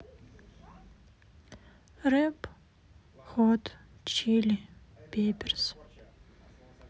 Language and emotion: Russian, sad